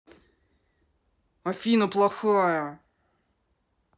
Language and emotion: Russian, angry